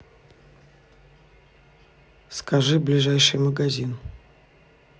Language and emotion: Russian, neutral